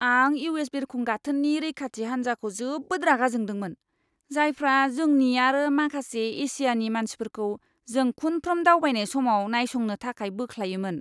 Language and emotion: Bodo, disgusted